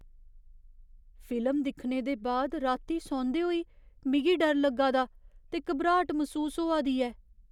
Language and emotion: Dogri, fearful